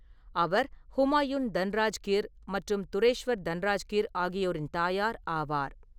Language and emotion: Tamil, neutral